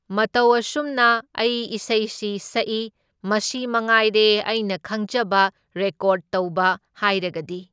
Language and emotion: Manipuri, neutral